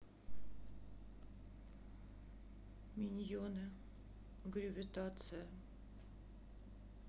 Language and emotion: Russian, sad